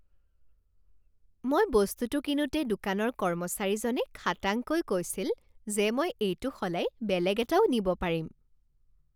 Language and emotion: Assamese, happy